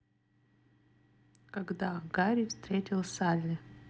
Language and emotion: Russian, neutral